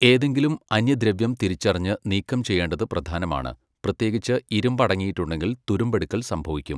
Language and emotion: Malayalam, neutral